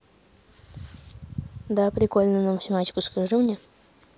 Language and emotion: Russian, neutral